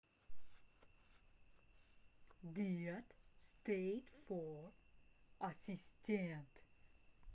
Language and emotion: Russian, neutral